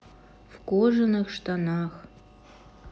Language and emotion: Russian, neutral